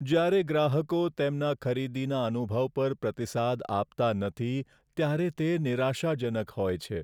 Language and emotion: Gujarati, sad